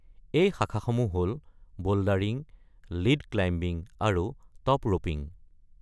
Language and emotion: Assamese, neutral